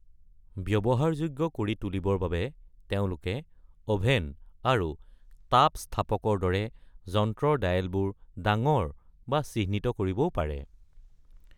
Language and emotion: Assamese, neutral